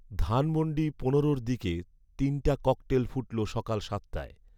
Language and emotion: Bengali, neutral